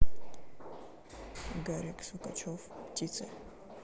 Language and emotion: Russian, neutral